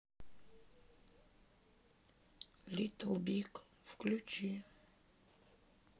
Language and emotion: Russian, sad